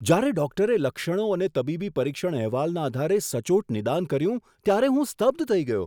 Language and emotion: Gujarati, surprised